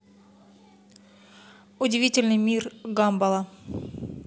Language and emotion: Russian, neutral